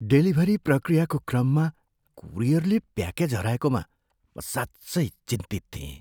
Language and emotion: Nepali, fearful